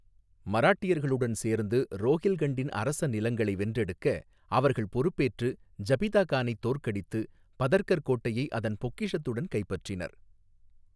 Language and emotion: Tamil, neutral